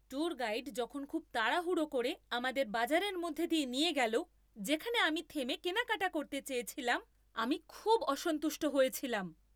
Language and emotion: Bengali, angry